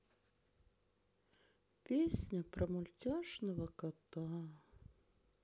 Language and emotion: Russian, sad